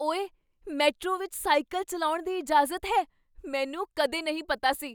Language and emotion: Punjabi, surprised